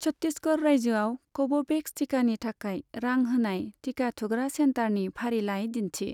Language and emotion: Bodo, neutral